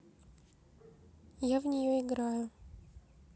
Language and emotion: Russian, neutral